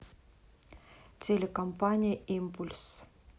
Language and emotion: Russian, neutral